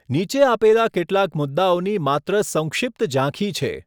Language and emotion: Gujarati, neutral